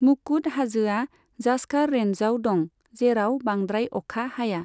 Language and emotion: Bodo, neutral